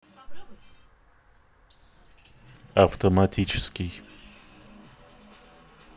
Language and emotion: Russian, neutral